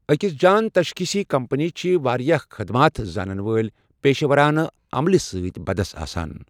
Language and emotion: Kashmiri, neutral